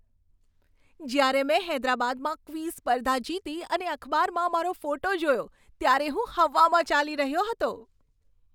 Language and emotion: Gujarati, happy